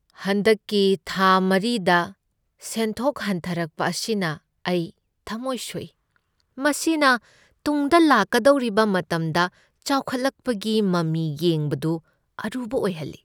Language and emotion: Manipuri, sad